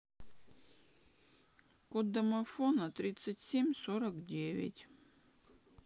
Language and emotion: Russian, sad